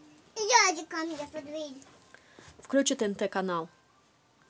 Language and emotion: Russian, neutral